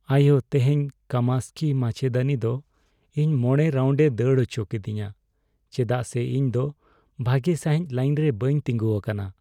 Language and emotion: Santali, sad